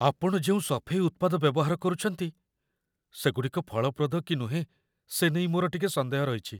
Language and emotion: Odia, fearful